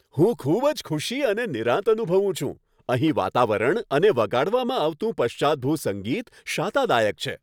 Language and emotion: Gujarati, happy